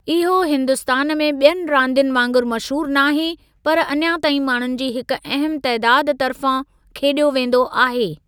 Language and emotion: Sindhi, neutral